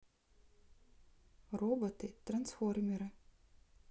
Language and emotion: Russian, neutral